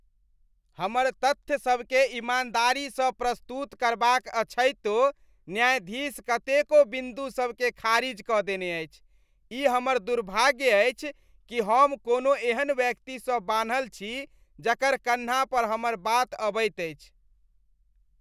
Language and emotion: Maithili, disgusted